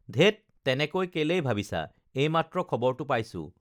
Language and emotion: Assamese, neutral